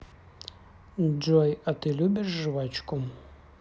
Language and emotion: Russian, neutral